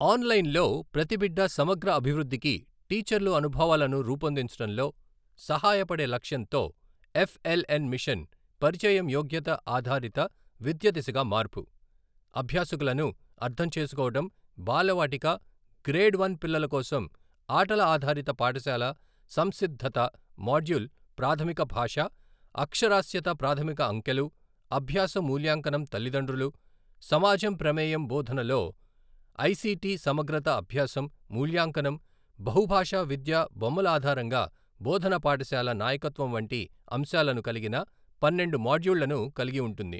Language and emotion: Telugu, neutral